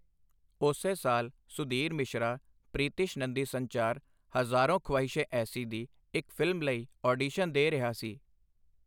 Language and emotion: Punjabi, neutral